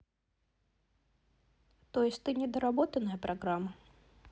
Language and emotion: Russian, neutral